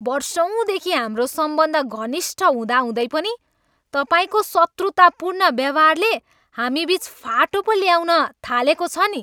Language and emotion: Nepali, angry